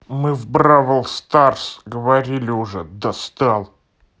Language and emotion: Russian, angry